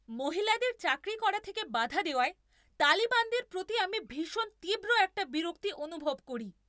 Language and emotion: Bengali, angry